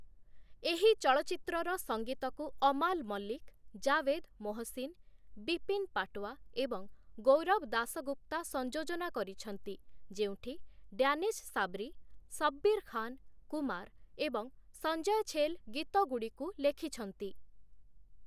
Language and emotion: Odia, neutral